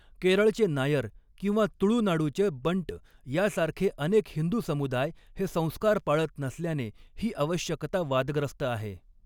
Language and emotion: Marathi, neutral